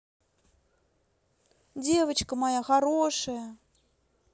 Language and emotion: Russian, positive